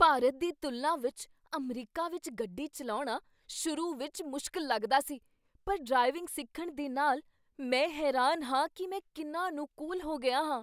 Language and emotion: Punjabi, surprised